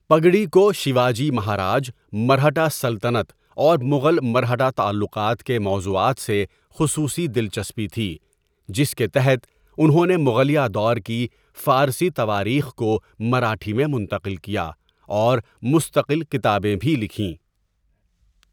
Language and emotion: Urdu, neutral